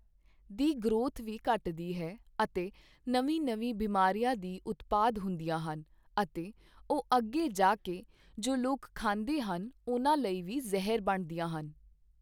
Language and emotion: Punjabi, neutral